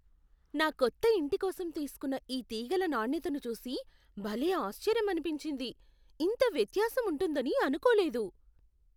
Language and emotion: Telugu, surprised